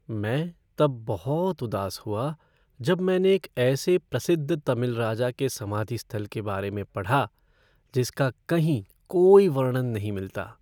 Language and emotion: Hindi, sad